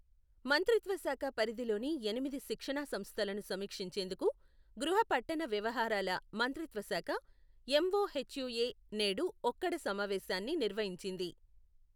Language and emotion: Telugu, neutral